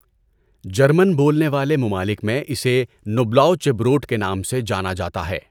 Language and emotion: Urdu, neutral